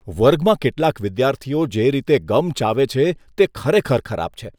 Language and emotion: Gujarati, disgusted